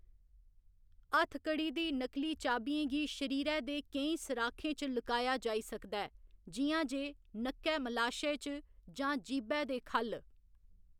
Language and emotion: Dogri, neutral